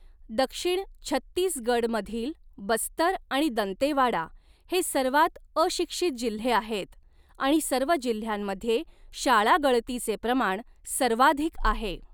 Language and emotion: Marathi, neutral